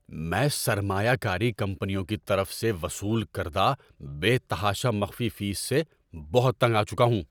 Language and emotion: Urdu, angry